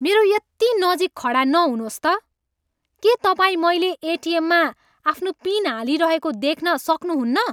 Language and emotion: Nepali, angry